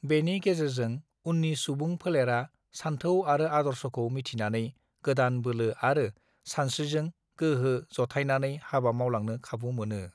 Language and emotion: Bodo, neutral